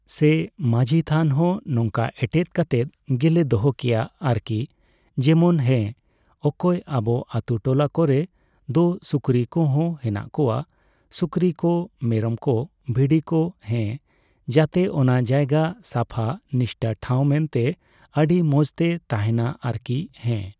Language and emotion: Santali, neutral